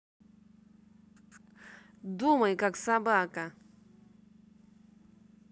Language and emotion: Russian, angry